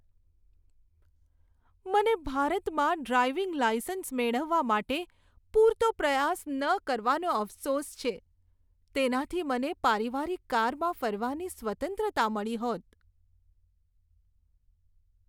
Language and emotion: Gujarati, sad